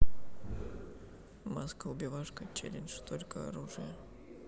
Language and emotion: Russian, neutral